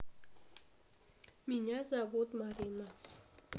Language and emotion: Russian, neutral